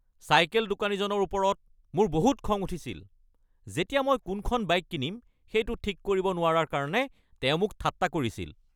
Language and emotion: Assamese, angry